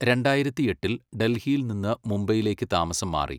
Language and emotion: Malayalam, neutral